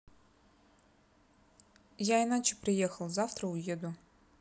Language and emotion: Russian, neutral